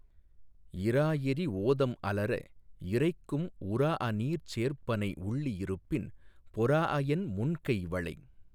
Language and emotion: Tamil, neutral